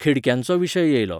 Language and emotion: Goan Konkani, neutral